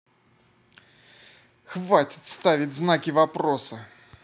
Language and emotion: Russian, angry